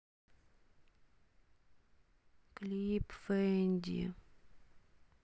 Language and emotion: Russian, sad